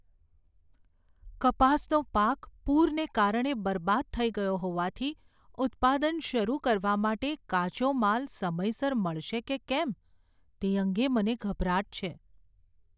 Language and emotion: Gujarati, fearful